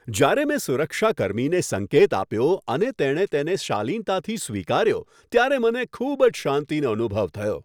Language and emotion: Gujarati, happy